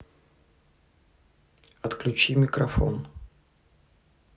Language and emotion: Russian, neutral